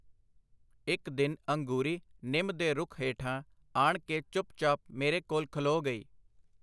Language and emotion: Punjabi, neutral